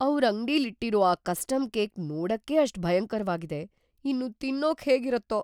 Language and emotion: Kannada, fearful